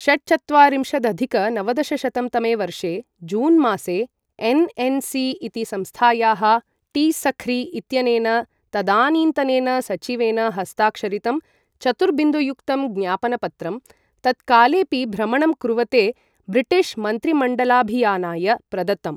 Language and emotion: Sanskrit, neutral